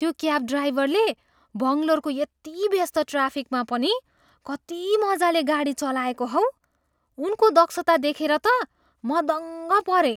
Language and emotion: Nepali, surprised